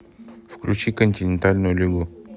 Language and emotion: Russian, neutral